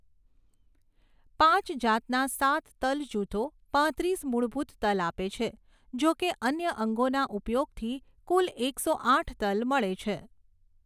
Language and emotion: Gujarati, neutral